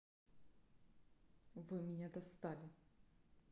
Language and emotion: Russian, angry